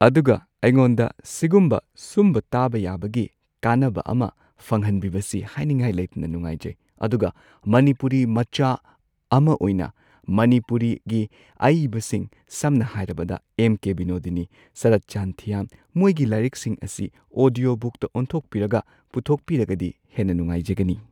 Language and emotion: Manipuri, neutral